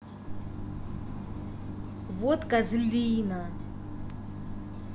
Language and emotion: Russian, angry